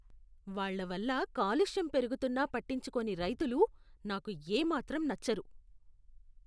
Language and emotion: Telugu, disgusted